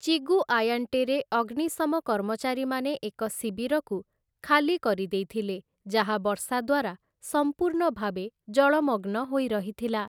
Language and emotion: Odia, neutral